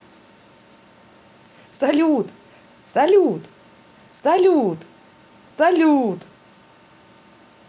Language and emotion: Russian, positive